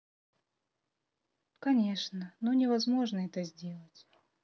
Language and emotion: Russian, sad